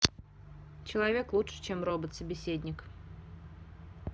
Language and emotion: Russian, neutral